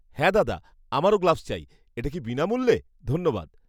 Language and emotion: Bengali, happy